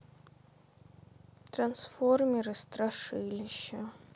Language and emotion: Russian, sad